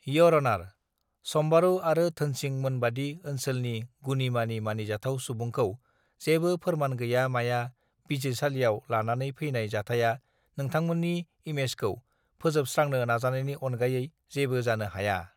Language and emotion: Bodo, neutral